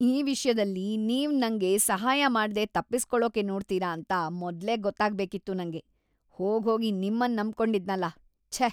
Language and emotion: Kannada, disgusted